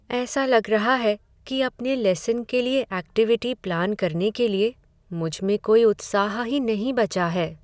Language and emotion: Hindi, sad